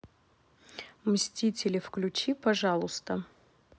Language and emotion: Russian, neutral